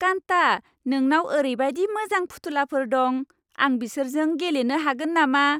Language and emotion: Bodo, happy